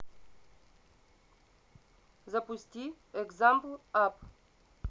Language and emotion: Russian, neutral